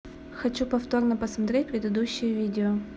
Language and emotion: Russian, neutral